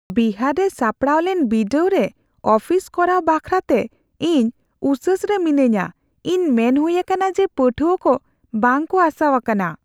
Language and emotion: Santali, fearful